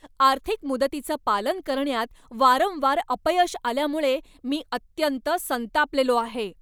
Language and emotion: Marathi, angry